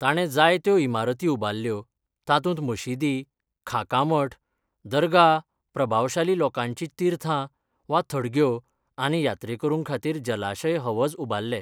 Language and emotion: Goan Konkani, neutral